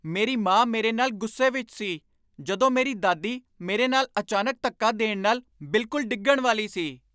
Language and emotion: Punjabi, angry